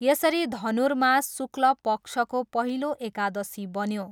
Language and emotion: Nepali, neutral